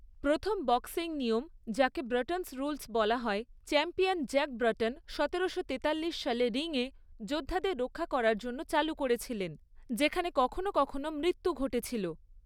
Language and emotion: Bengali, neutral